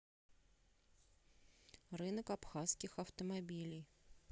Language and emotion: Russian, neutral